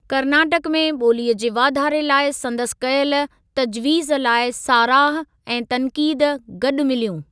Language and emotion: Sindhi, neutral